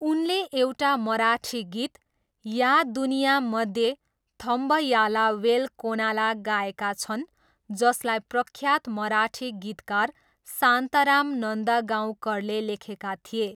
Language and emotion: Nepali, neutral